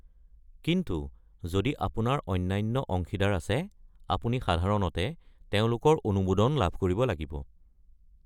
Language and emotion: Assamese, neutral